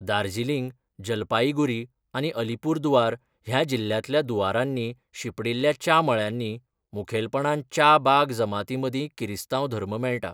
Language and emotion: Goan Konkani, neutral